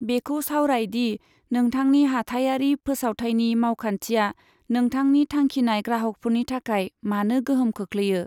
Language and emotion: Bodo, neutral